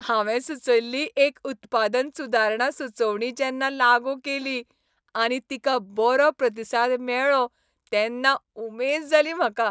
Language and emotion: Goan Konkani, happy